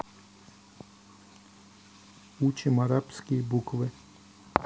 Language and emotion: Russian, neutral